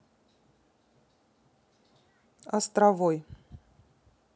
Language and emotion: Russian, neutral